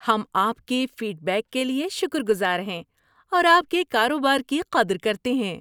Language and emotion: Urdu, happy